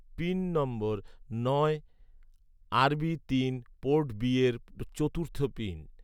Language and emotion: Bengali, neutral